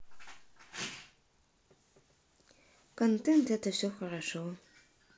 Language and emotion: Russian, sad